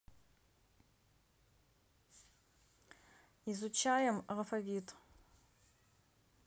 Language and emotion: Russian, neutral